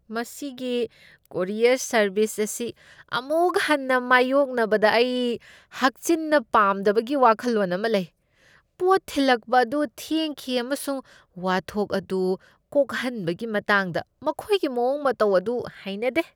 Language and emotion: Manipuri, disgusted